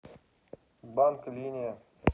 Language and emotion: Russian, neutral